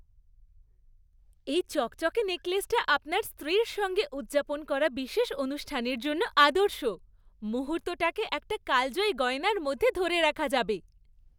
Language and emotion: Bengali, happy